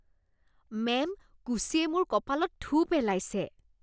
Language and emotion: Assamese, disgusted